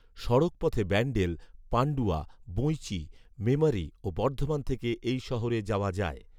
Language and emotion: Bengali, neutral